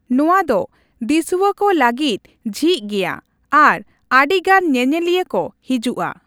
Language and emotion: Santali, neutral